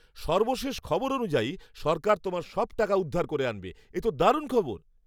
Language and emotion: Bengali, happy